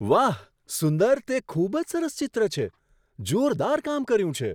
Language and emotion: Gujarati, surprised